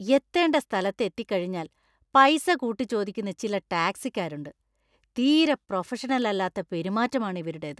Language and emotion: Malayalam, disgusted